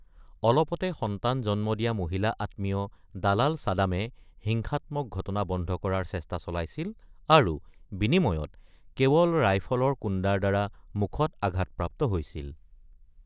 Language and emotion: Assamese, neutral